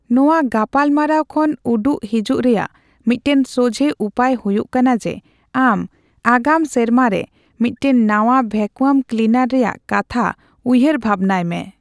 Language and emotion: Santali, neutral